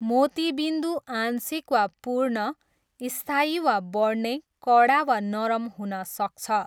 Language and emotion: Nepali, neutral